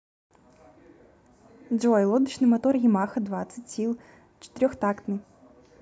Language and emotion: Russian, neutral